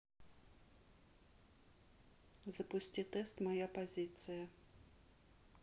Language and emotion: Russian, neutral